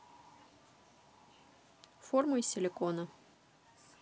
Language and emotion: Russian, neutral